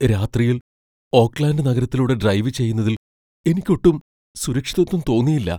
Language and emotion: Malayalam, fearful